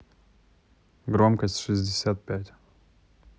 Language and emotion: Russian, neutral